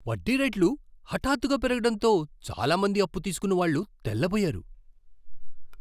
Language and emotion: Telugu, surprised